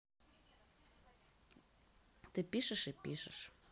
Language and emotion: Russian, neutral